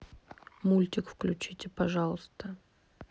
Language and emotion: Russian, neutral